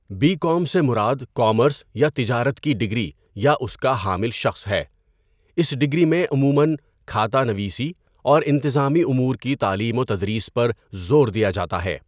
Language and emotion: Urdu, neutral